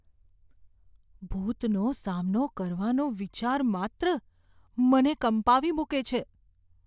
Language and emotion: Gujarati, fearful